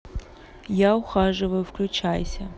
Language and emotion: Russian, neutral